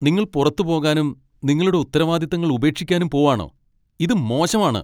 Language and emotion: Malayalam, angry